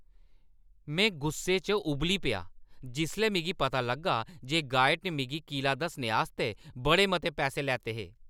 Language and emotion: Dogri, angry